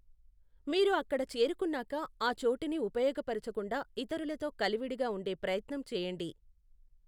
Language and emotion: Telugu, neutral